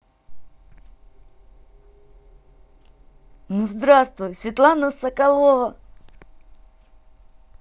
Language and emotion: Russian, positive